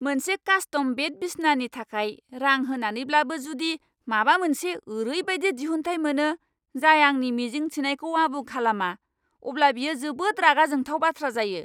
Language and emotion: Bodo, angry